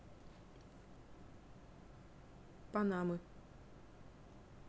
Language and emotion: Russian, neutral